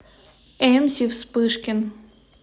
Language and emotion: Russian, neutral